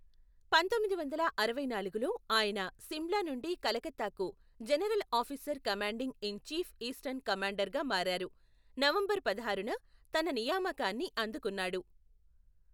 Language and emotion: Telugu, neutral